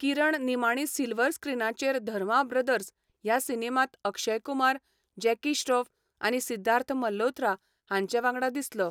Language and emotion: Goan Konkani, neutral